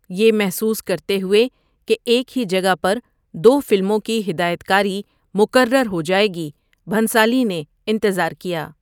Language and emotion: Urdu, neutral